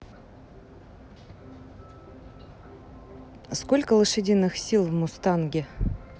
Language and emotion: Russian, neutral